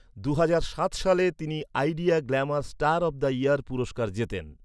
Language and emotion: Bengali, neutral